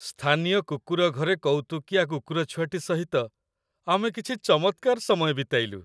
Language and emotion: Odia, happy